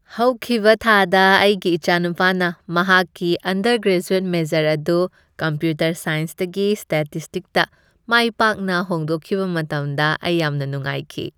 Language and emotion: Manipuri, happy